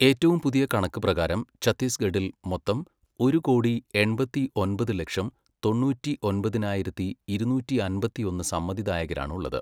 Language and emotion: Malayalam, neutral